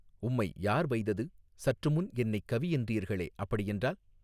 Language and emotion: Tamil, neutral